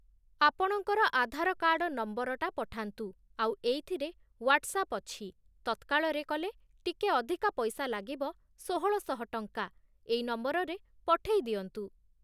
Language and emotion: Odia, neutral